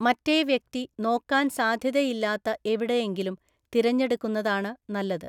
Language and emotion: Malayalam, neutral